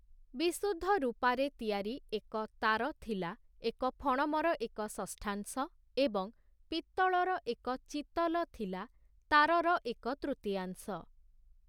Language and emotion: Odia, neutral